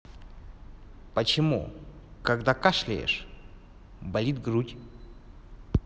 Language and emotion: Russian, neutral